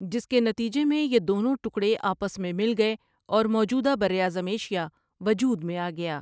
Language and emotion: Urdu, neutral